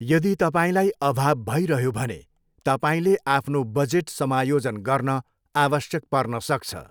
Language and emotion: Nepali, neutral